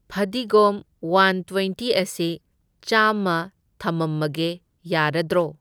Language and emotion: Manipuri, neutral